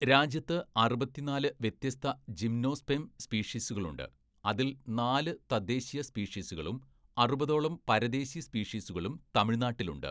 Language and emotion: Malayalam, neutral